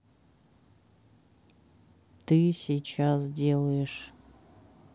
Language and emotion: Russian, neutral